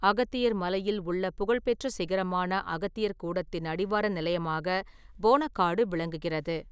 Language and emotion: Tamil, neutral